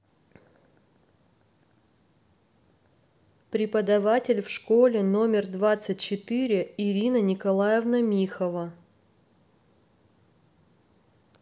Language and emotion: Russian, neutral